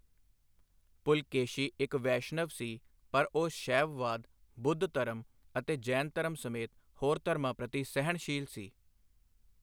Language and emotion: Punjabi, neutral